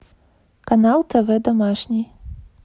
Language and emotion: Russian, neutral